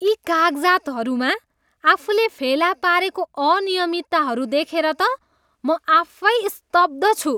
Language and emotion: Nepali, disgusted